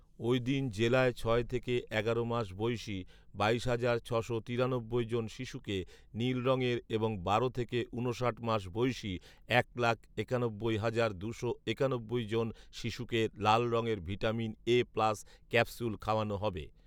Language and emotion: Bengali, neutral